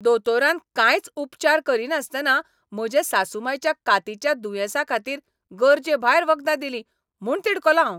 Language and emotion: Goan Konkani, angry